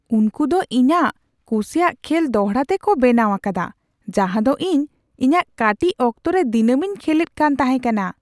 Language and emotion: Santali, surprised